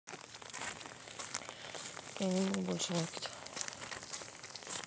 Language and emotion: Russian, neutral